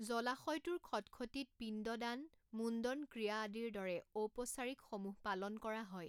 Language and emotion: Assamese, neutral